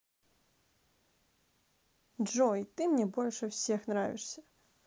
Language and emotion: Russian, neutral